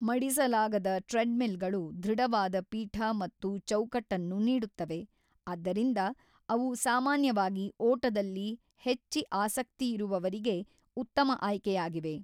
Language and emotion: Kannada, neutral